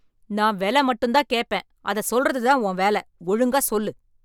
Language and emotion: Tamil, angry